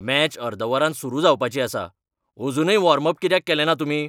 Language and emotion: Goan Konkani, angry